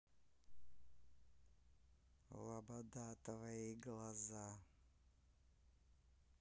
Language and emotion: Russian, neutral